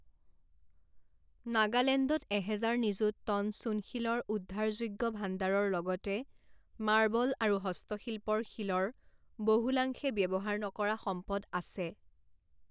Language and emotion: Assamese, neutral